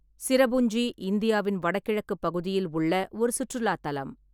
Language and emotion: Tamil, neutral